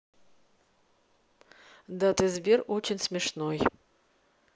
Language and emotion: Russian, neutral